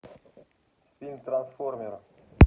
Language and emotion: Russian, neutral